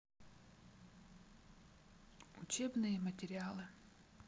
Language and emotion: Russian, neutral